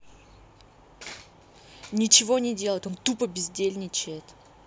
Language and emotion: Russian, angry